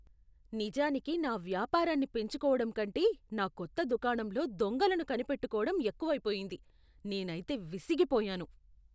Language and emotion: Telugu, disgusted